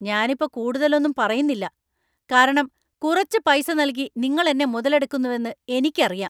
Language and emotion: Malayalam, angry